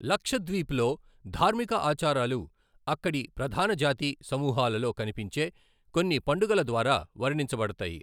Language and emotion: Telugu, neutral